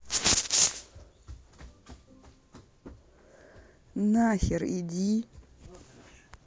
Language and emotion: Russian, angry